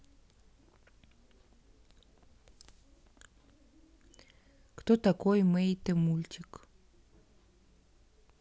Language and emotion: Russian, neutral